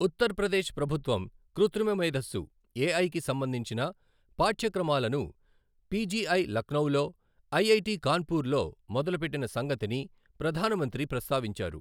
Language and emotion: Telugu, neutral